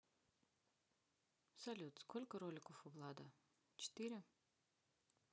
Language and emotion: Russian, neutral